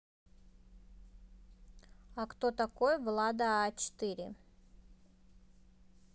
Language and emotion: Russian, neutral